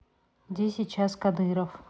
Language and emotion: Russian, neutral